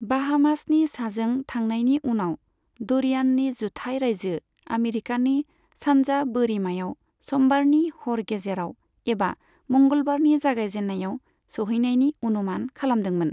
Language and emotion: Bodo, neutral